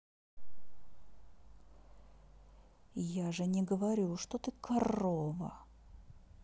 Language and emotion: Russian, angry